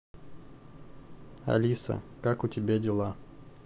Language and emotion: Russian, neutral